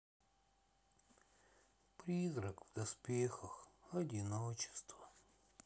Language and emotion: Russian, sad